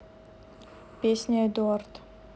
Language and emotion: Russian, neutral